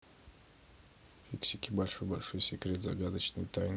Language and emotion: Russian, neutral